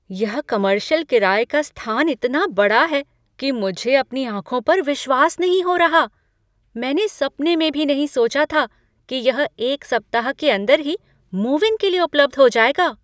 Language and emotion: Hindi, surprised